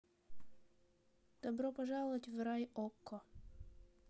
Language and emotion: Russian, neutral